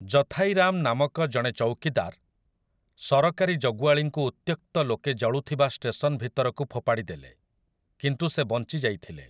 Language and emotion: Odia, neutral